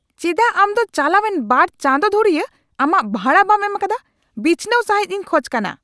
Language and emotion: Santali, angry